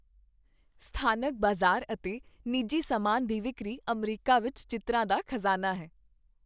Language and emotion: Punjabi, happy